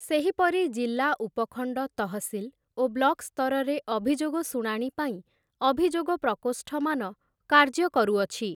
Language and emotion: Odia, neutral